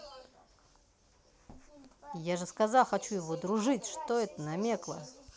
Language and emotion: Russian, angry